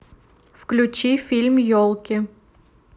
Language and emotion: Russian, neutral